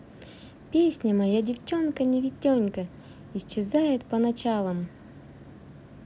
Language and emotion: Russian, positive